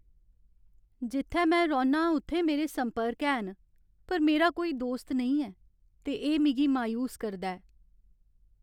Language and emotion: Dogri, sad